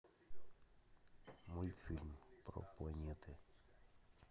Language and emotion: Russian, neutral